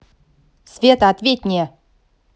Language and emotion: Russian, angry